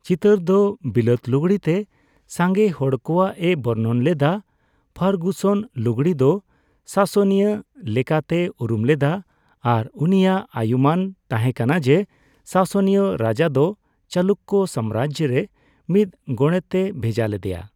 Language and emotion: Santali, neutral